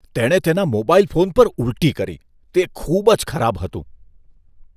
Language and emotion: Gujarati, disgusted